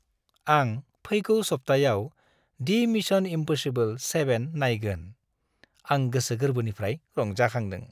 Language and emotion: Bodo, happy